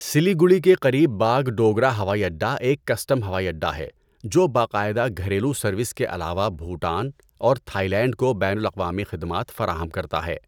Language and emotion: Urdu, neutral